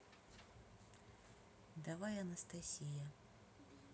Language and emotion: Russian, neutral